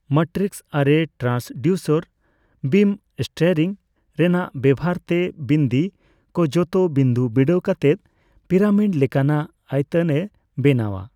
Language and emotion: Santali, neutral